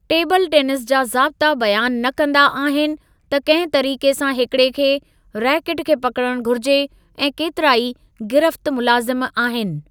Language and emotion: Sindhi, neutral